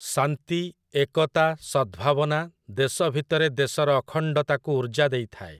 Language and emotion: Odia, neutral